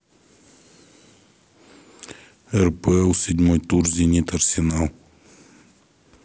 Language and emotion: Russian, neutral